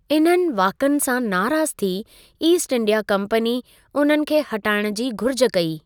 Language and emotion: Sindhi, neutral